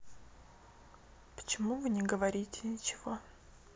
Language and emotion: Russian, neutral